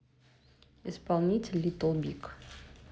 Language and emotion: Russian, neutral